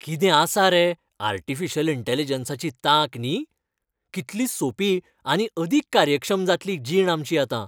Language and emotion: Goan Konkani, happy